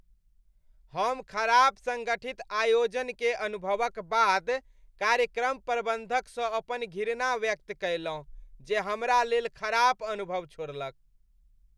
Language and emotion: Maithili, disgusted